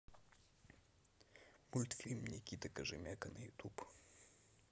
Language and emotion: Russian, neutral